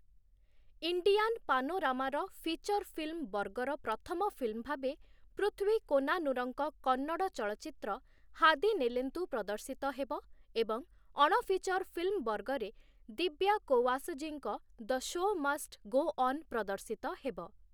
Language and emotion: Odia, neutral